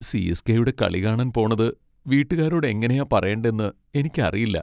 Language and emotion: Malayalam, sad